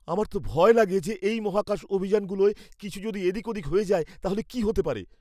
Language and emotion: Bengali, fearful